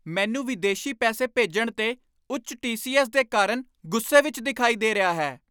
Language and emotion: Punjabi, angry